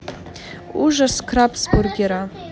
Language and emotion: Russian, neutral